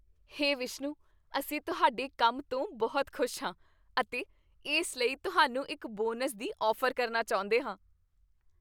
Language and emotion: Punjabi, happy